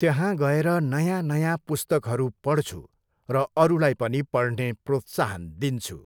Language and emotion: Nepali, neutral